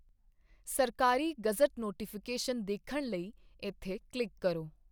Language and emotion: Punjabi, neutral